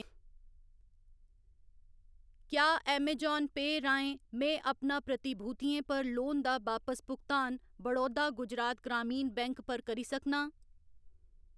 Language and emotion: Dogri, neutral